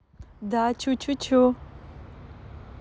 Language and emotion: Russian, positive